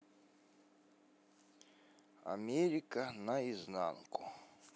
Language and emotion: Russian, neutral